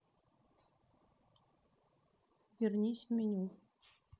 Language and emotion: Russian, neutral